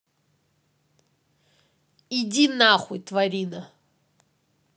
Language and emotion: Russian, angry